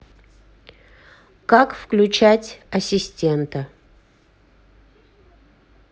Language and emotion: Russian, neutral